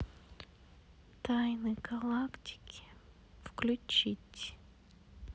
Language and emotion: Russian, sad